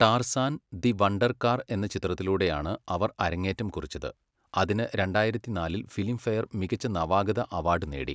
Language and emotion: Malayalam, neutral